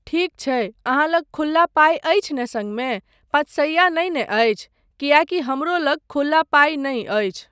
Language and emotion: Maithili, neutral